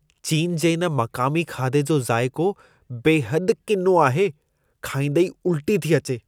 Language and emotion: Sindhi, disgusted